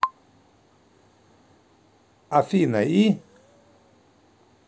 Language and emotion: Russian, neutral